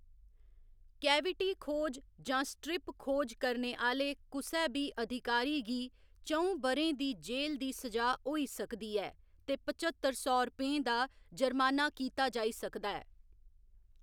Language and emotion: Dogri, neutral